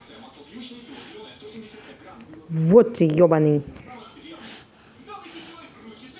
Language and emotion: Russian, angry